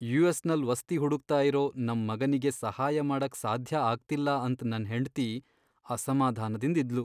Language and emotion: Kannada, sad